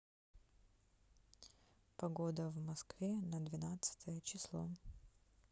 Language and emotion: Russian, neutral